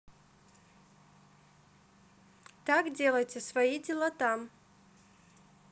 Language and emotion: Russian, neutral